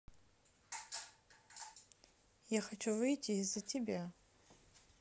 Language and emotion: Russian, neutral